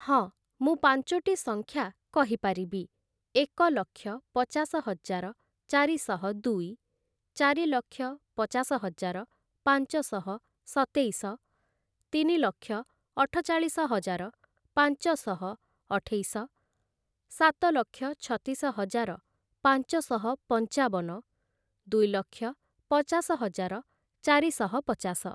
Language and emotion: Odia, neutral